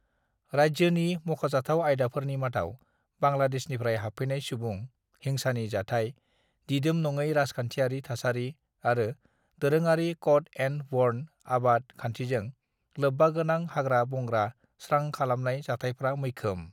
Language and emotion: Bodo, neutral